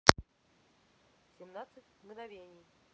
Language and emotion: Russian, neutral